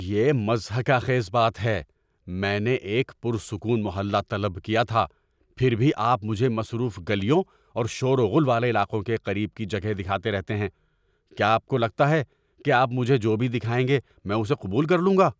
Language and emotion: Urdu, angry